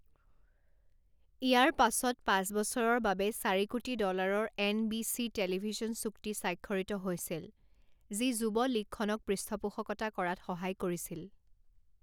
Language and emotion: Assamese, neutral